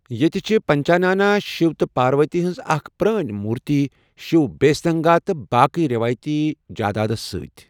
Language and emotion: Kashmiri, neutral